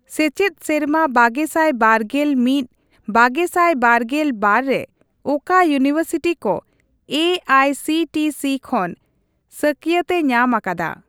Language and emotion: Santali, neutral